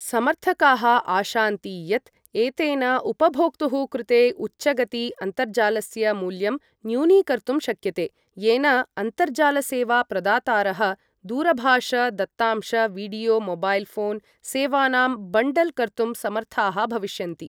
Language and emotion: Sanskrit, neutral